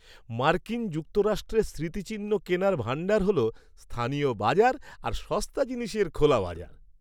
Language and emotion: Bengali, happy